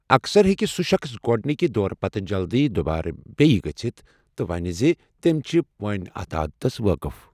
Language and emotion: Kashmiri, neutral